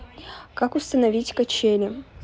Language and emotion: Russian, neutral